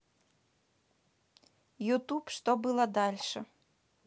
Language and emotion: Russian, neutral